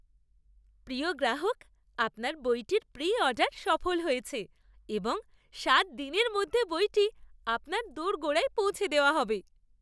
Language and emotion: Bengali, happy